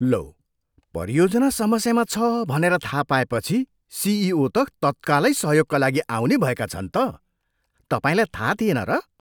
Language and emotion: Nepali, surprised